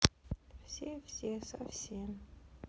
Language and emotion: Russian, sad